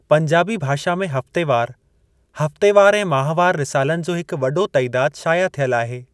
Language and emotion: Sindhi, neutral